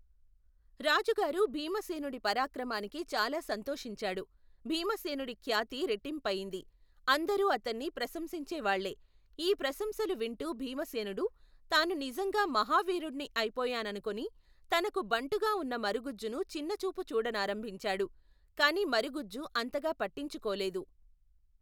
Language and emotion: Telugu, neutral